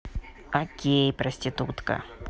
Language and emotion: Russian, neutral